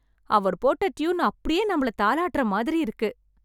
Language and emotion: Tamil, happy